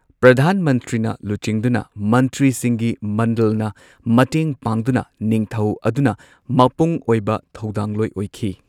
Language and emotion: Manipuri, neutral